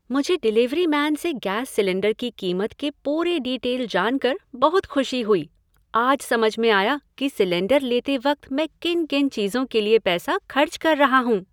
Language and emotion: Hindi, happy